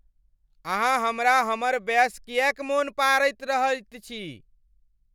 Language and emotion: Maithili, angry